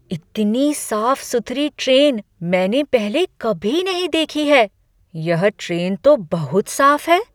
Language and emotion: Hindi, surprised